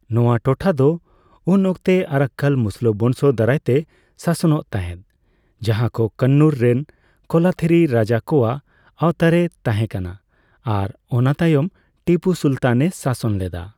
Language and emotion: Santali, neutral